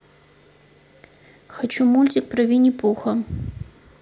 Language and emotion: Russian, neutral